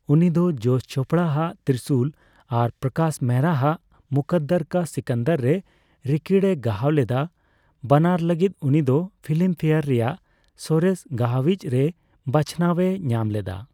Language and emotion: Santali, neutral